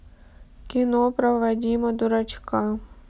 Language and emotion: Russian, sad